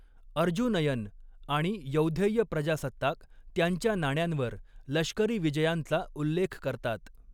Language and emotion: Marathi, neutral